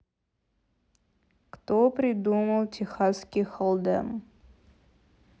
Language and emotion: Russian, neutral